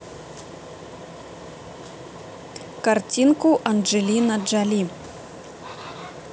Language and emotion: Russian, neutral